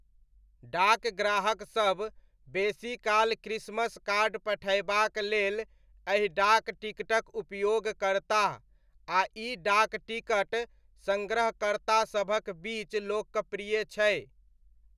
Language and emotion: Maithili, neutral